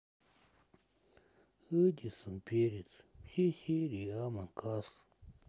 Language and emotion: Russian, sad